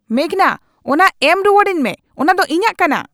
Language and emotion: Santali, angry